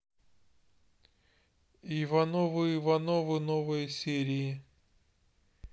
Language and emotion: Russian, neutral